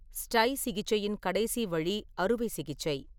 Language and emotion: Tamil, neutral